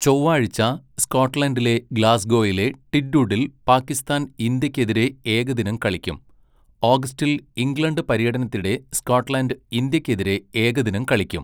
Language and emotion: Malayalam, neutral